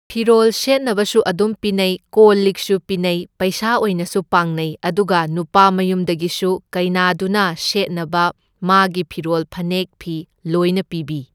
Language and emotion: Manipuri, neutral